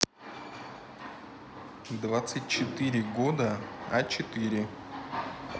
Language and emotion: Russian, neutral